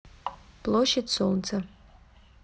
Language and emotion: Russian, neutral